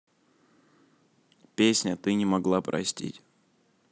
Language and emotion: Russian, neutral